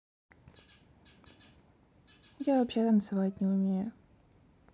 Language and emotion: Russian, sad